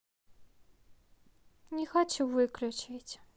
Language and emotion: Russian, sad